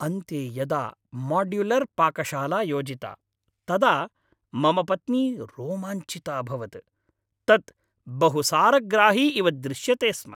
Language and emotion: Sanskrit, happy